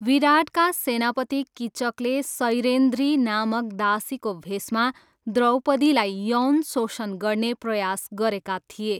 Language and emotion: Nepali, neutral